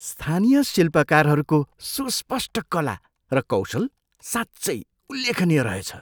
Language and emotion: Nepali, surprised